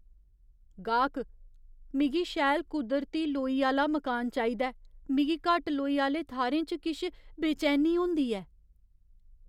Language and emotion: Dogri, fearful